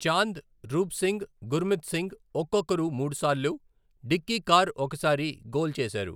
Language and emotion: Telugu, neutral